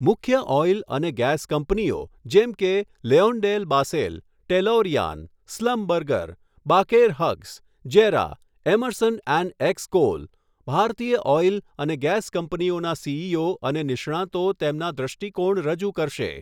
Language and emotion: Gujarati, neutral